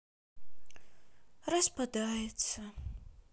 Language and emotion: Russian, sad